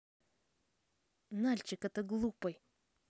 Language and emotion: Russian, angry